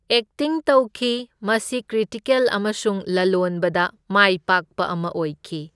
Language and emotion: Manipuri, neutral